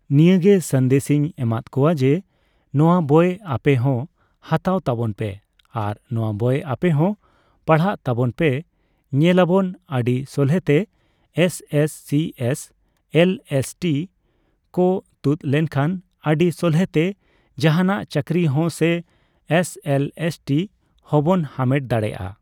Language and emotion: Santali, neutral